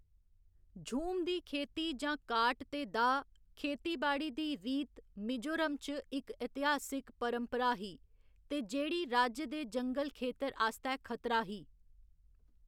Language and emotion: Dogri, neutral